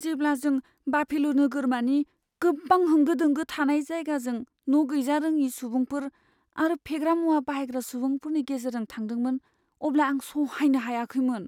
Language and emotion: Bodo, fearful